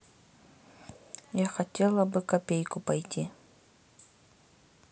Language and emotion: Russian, neutral